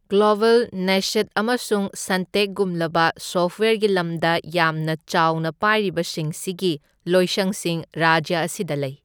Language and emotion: Manipuri, neutral